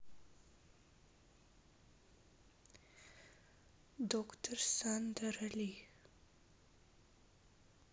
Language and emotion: Russian, sad